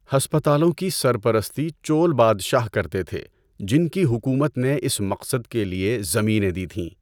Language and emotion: Urdu, neutral